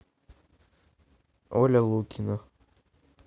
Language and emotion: Russian, neutral